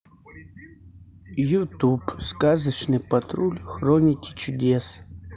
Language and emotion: Russian, neutral